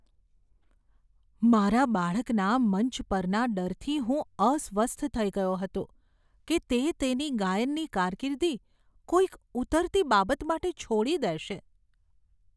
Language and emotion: Gujarati, fearful